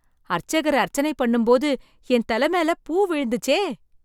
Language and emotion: Tamil, surprised